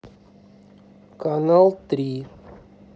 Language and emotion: Russian, neutral